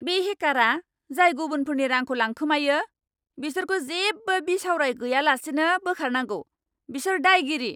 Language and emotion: Bodo, angry